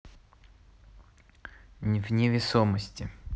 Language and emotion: Russian, neutral